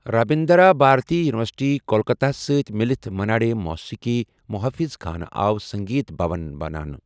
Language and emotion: Kashmiri, neutral